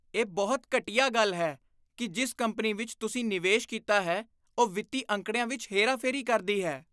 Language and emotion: Punjabi, disgusted